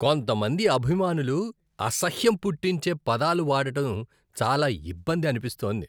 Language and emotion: Telugu, disgusted